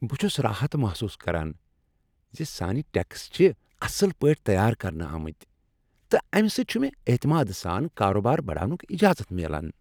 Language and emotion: Kashmiri, happy